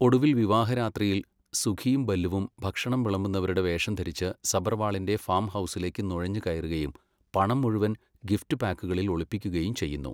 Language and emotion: Malayalam, neutral